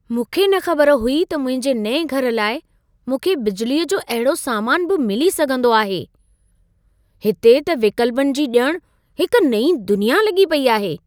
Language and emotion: Sindhi, surprised